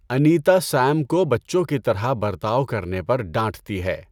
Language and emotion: Urdu, neutral